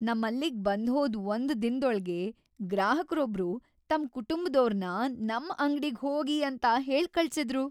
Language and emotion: Kannada, happy